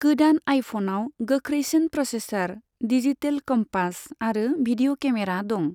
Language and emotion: Bodo, neutral